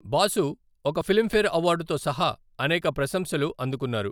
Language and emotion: Telugu, neutral